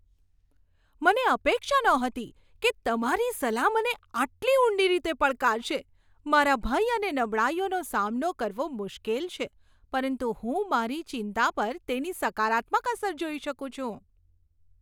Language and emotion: Gujarati, surprised